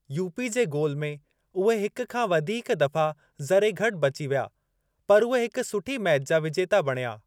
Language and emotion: Sindhi, neutral